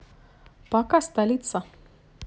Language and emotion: Russian, neutral